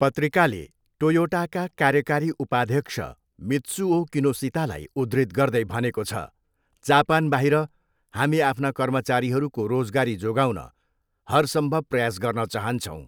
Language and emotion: Nepali, neutral